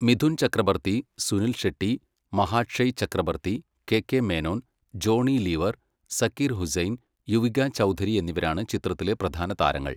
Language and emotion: Malayalam, neutral